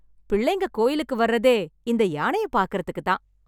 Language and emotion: Tamil, happy